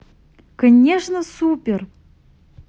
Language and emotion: Russian, positive